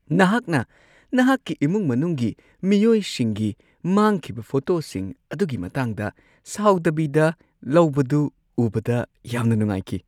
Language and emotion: Manipuri, happy